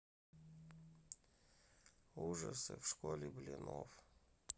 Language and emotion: Russian, neutral